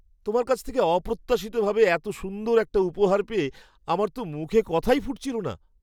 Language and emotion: Bengali, surprised